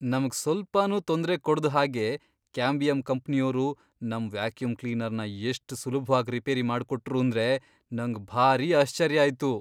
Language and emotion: Kannada, surprised